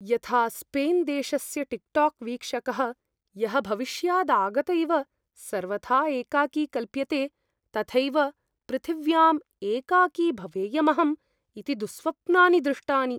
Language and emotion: Sanskrit, fearful